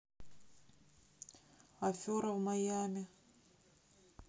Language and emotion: Russian, sad